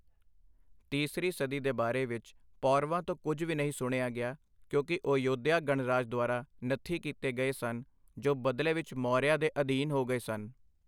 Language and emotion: Punjabi, neutral